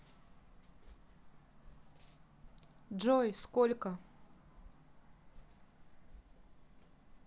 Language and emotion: Russian, neutral